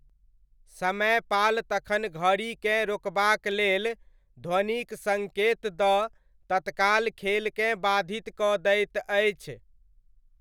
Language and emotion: Maithili, neutral